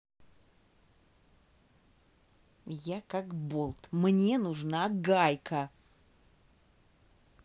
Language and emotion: Russian, angry